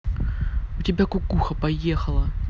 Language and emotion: Russian, angry